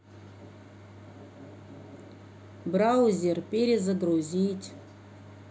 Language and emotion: Russian, neutral